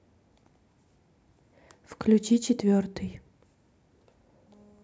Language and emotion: Russian, neutral